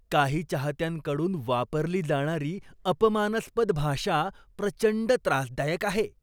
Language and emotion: Marathi, disgusted